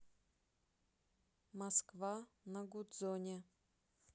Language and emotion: Russian, neutral